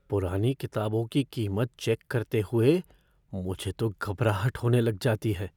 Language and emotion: Hindi, fearful